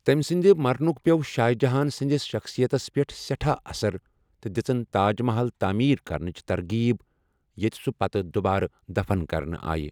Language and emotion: Kashmiri, neutral